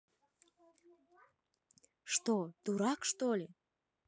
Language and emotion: Russian, neutral